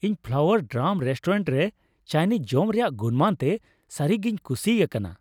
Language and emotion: Santali, happy